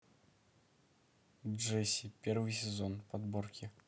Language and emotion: Russian, neutral